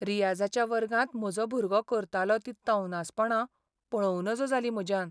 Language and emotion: Goan Konkani, sad